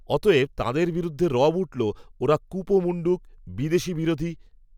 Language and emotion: Bengali, neutral